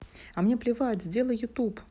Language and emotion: Russian, neutral